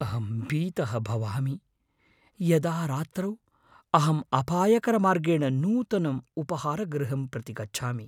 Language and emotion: Sanskrit, fearful